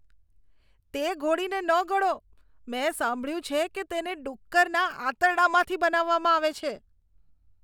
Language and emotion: Gujarati, disgusted